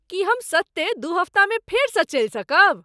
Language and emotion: Maithili, surprised